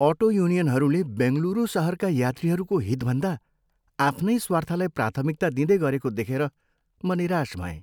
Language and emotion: Nepali, sad